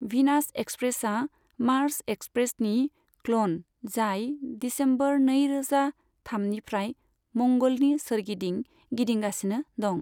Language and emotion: Bodo, neutral